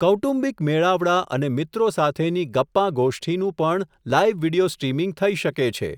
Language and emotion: Gujarati, neutral